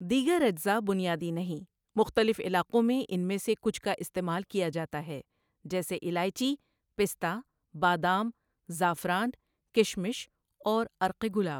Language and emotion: Urdu, neutral